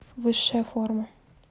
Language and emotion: Russian, neutral